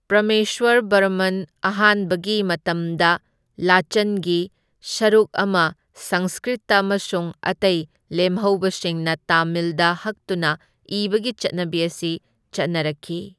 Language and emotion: Manipuri, neutral